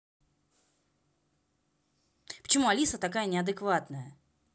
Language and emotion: Russian, angry